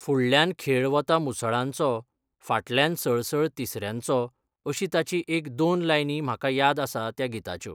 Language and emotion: Goan Konkani, neutral